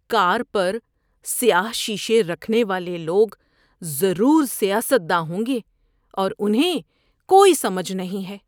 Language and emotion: Urdu, disgusted